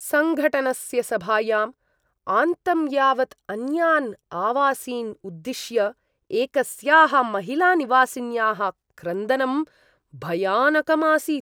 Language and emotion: Sanskrit, disgusted